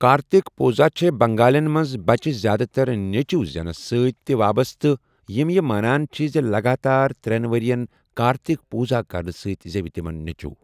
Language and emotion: Kashmiri, neutral